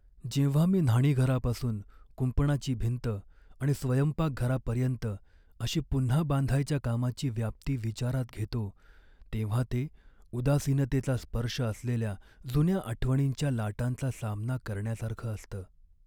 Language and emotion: Marathi, sad